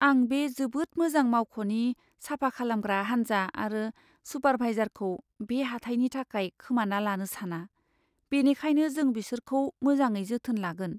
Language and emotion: Bodo, fearful